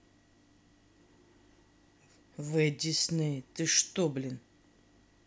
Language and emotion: Russian, angry